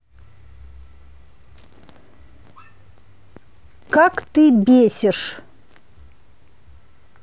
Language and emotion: Russian, angry